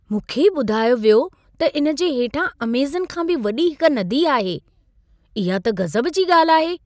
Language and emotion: Sindhi, surprised